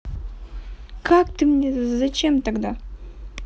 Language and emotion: Russian, neutral